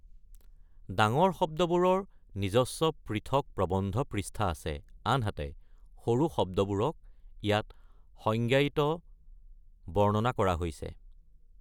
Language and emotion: Assamese, neutral